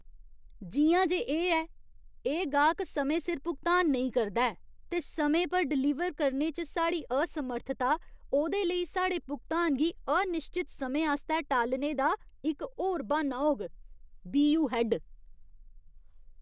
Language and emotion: Dogri, disgusted